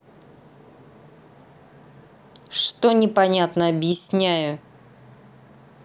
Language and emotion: Russian, angry